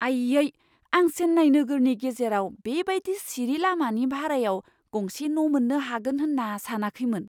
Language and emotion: Bodo, surprised